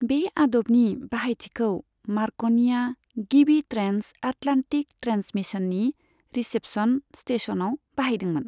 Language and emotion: Bodo, neutral